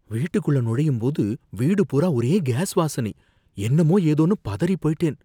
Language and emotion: Tamil, fearful